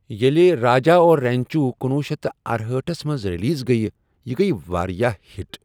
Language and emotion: Kashmiri, neutral